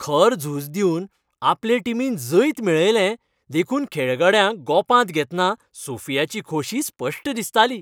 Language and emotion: Goan Konkani, happy